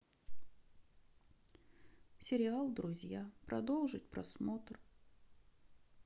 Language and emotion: Russian, sad